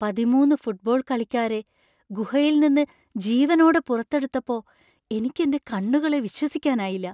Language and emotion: Malayalam, surprised